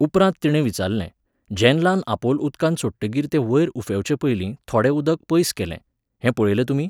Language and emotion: Goan Konkani, neutral